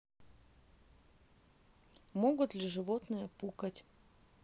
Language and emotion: Russian, neutral